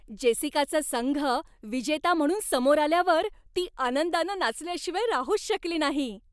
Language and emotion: Marathi, happy